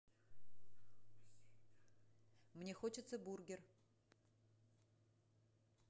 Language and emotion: Russian, neutral